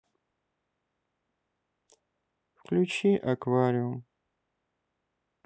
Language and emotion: Russian, sad